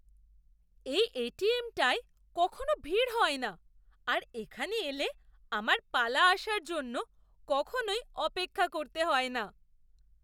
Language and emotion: Bengali, surprised